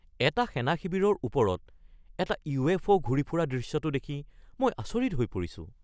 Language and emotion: Assamese, surprised